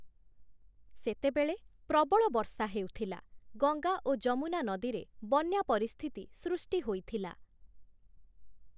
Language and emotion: Odia, neutral